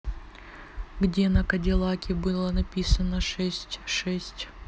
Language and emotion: Russian, neutral